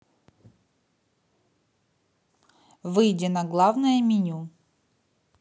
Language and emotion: Russian, neutral